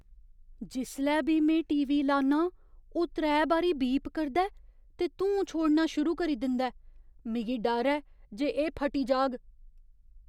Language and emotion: Dogri, fearful